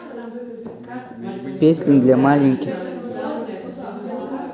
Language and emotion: Russian, neutral